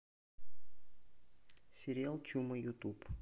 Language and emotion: Russian, neutral